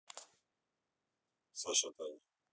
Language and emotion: Russian, neutral